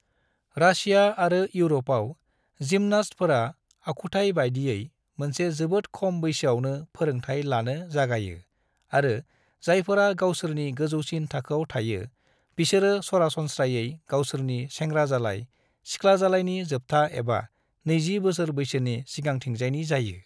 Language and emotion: Bodo, neutral